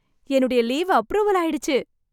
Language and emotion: Tamil, happy